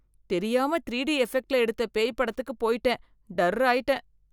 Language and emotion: Tamil, fearful